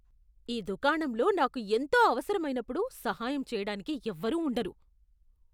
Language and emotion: Telugu, disgusted